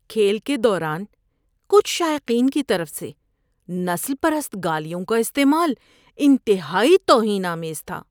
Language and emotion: Urdu, disgusted